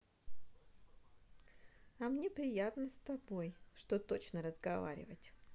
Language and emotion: Russian, positive